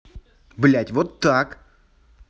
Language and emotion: Russian, angry